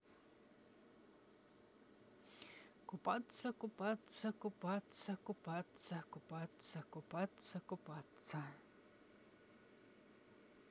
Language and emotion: Russian, neutral